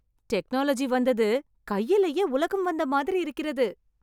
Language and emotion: Tamil, happy